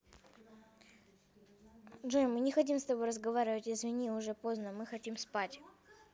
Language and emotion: Russian, neutral